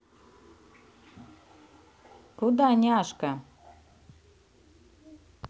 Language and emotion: Russian, positive